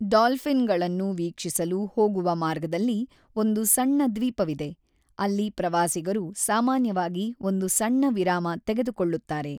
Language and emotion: Kannada, neutral